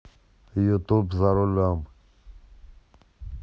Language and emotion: Russian, neutral